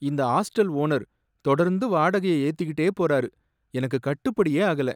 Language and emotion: Tamil, sad